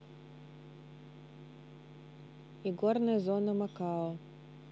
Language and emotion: Russian, neutral